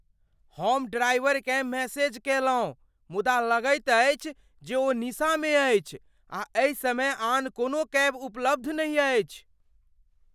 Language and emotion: Maithili, fearful